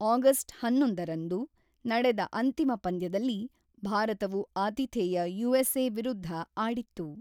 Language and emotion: Kannada, neutral